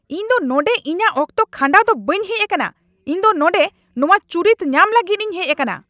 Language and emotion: Santali, angry